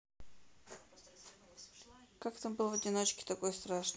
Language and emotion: Russian, neutral